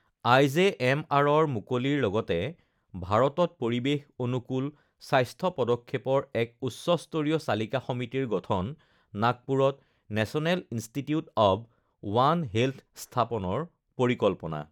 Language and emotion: Assamese, neutral